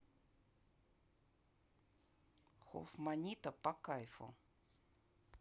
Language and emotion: Russian, neutral